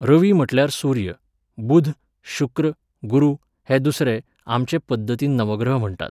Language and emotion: Goan Konkani, neutral